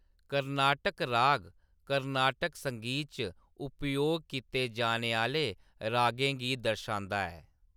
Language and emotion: Dogri, neutral